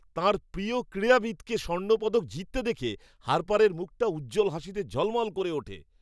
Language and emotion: Bengali, happy